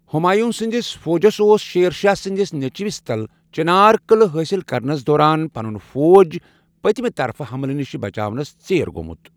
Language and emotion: Kashmiri, neutral